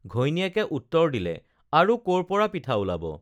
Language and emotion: Assamese, neutral